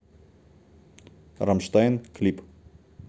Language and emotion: Russian, neutral